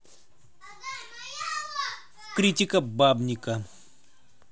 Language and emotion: Russian, neutral